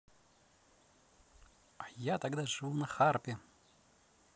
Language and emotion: Russian, positive